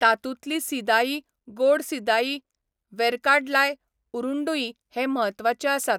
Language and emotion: Goan Konkani, neutral